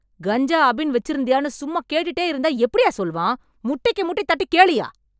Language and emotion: Tamil, angry